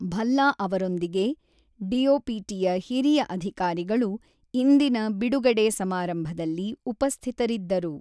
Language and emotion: Kannada, neutral